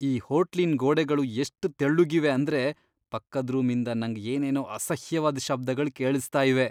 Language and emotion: Kannada, disgusted